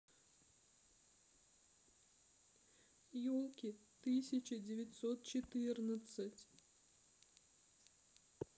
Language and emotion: Russian, sad